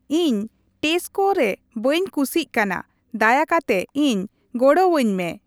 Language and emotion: Santali, neutral